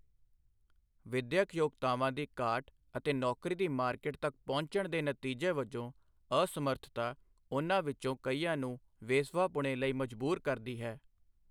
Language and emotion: Punjabi, neutral